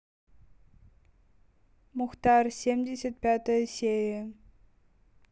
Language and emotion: Russian, neutral